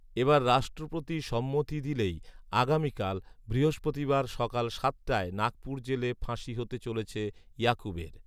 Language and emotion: Bengali, neutral